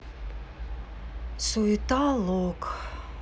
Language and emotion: Russian, sad